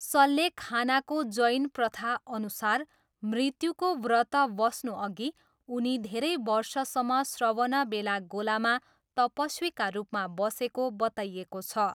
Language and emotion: Nepali, neutral